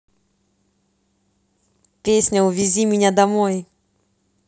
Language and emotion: Russian, positive